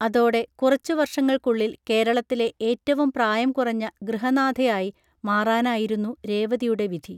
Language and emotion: Malayalam, neutral